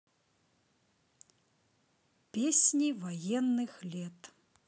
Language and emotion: Russian, neutral